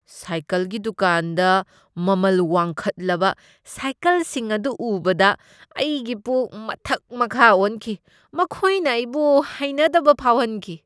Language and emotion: Manipuri, disgusted